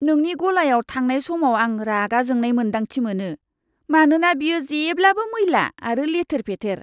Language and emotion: Bodo, disgusted